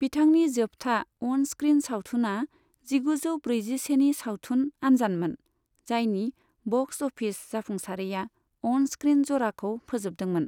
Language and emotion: Bodo, neutral